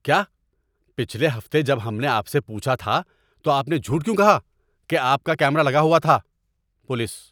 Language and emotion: Urdu, angry